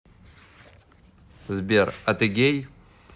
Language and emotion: Russian, neutral